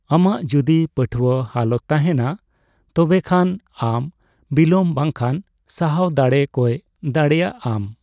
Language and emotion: Santali, neutral